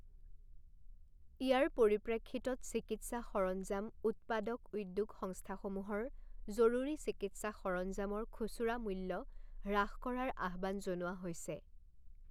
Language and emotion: Assamese, neutral